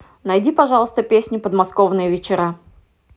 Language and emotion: Russian, neutral